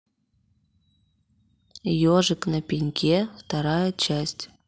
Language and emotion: Russian, neutral